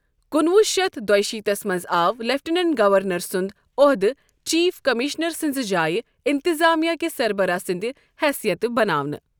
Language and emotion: Kashmiri, neutral